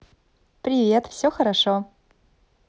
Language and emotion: Russian, positive